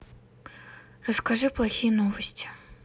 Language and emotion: Russian, sad